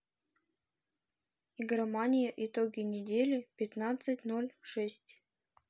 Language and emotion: Russian, neutral